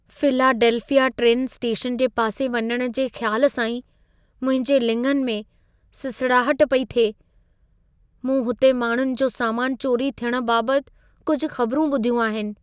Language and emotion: Sindhi, fearful